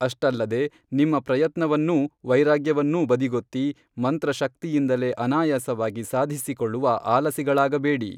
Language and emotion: Kannada, neutral